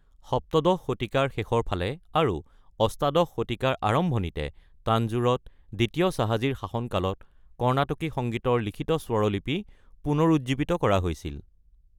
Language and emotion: Assamese, neutral